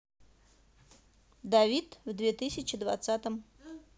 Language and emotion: Russian, neutral